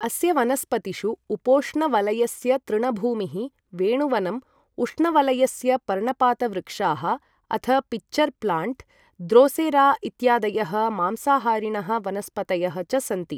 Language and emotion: Sanskrit, neutral